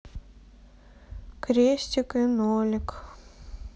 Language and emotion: Russian, sad